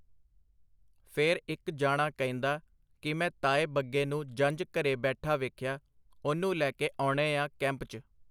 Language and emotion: Punjabi, neutral